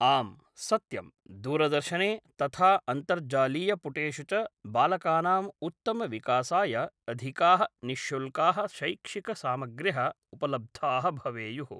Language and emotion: Sanskrit, neutral